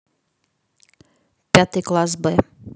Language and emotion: Russian, neutral